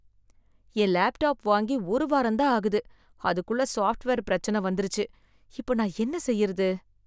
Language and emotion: Tamil, sad